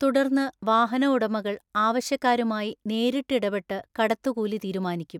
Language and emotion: Malayalam, neutral